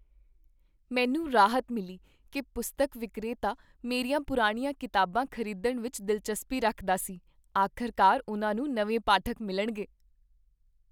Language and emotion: Punjabi, happy